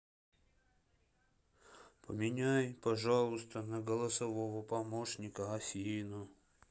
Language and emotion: Russian, sad